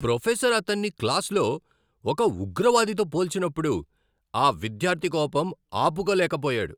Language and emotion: Telugu, angry